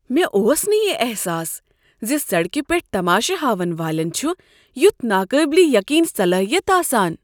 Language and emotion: Kashmiri, surprised